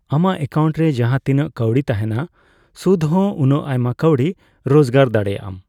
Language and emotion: Santali, neutral